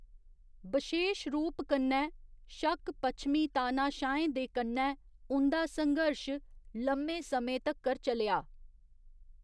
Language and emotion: Dogri, neutral